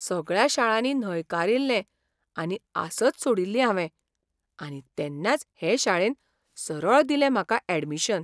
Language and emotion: Goan Konkani, surprised